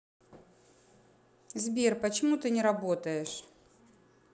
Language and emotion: Russian, neutral